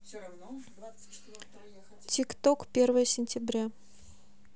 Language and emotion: Russian, neutral